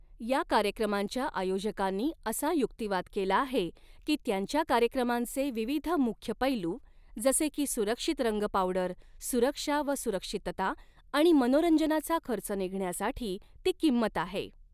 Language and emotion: Marathi, neutral